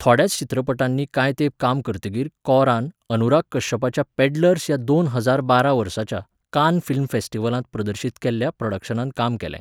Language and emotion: Goan Konkani, neutral